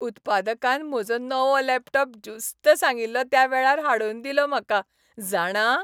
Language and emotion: Goan Konkani, happy